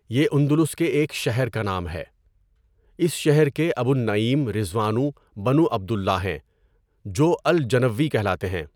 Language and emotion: Urdu, neutral